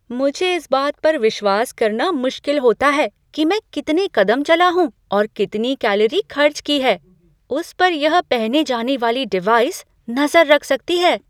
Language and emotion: Hindi, surprised